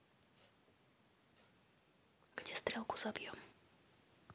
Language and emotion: Russian, neutral